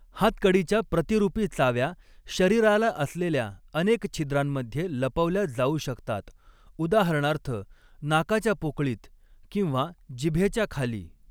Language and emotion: Marathi, neutral